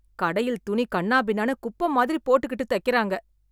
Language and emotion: Tamil, disgusted